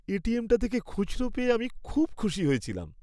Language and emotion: Bengali, happy